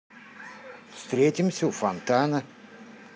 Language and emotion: Russian, neutral